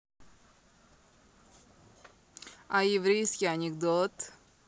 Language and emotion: Russian, positive